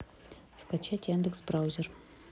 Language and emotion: Russian, neutral